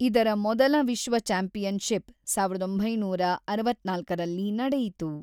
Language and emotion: Kannada, neutral